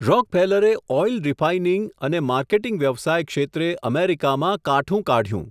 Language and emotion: Gujarati, neutral